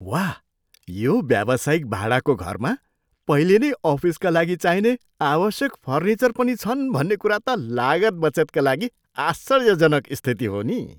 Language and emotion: Nepali, surprised